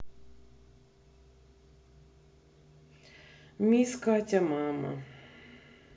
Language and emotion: Russian, sad